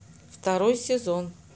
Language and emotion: Russian, neutral